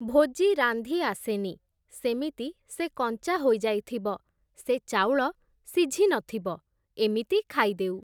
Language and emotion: Odia, neutral